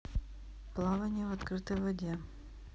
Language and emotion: Russian, neutral